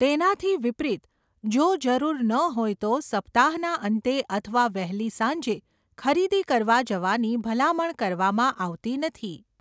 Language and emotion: Gujarati, neutral